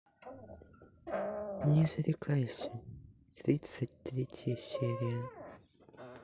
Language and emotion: Russian, sad